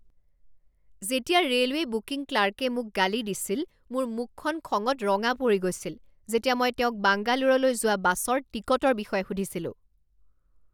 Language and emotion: Assamese, angry